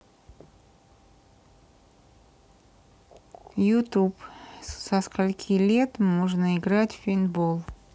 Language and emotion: Russian, neutral